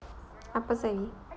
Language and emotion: Russian, neutral